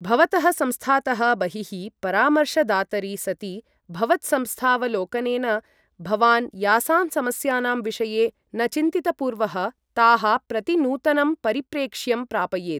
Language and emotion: Sanskrit, neutral